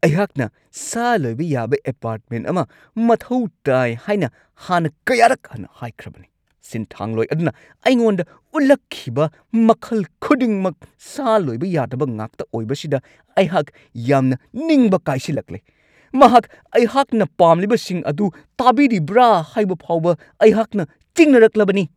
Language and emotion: Manipuri, angry